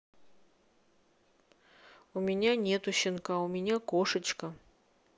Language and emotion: Russian, neutral